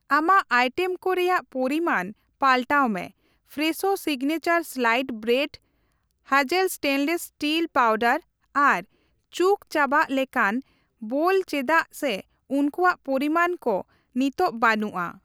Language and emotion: Santali, neutral